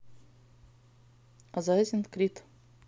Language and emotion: Russian, neutral